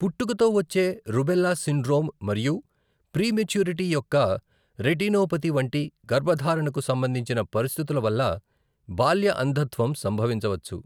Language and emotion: Telugu, neutral